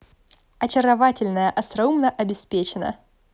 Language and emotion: Russian, positive